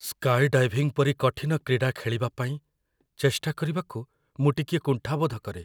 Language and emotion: Odia, fearful